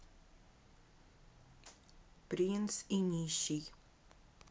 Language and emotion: Russian, neutral